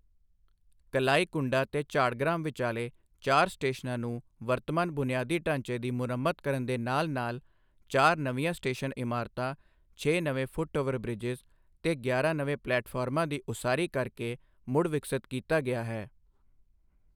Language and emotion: Punjabi, neutral